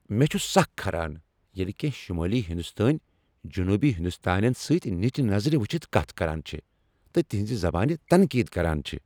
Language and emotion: Kashmiri, angry